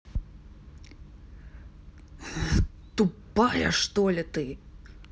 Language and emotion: Russian, angry